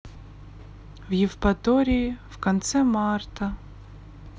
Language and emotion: Russian, sad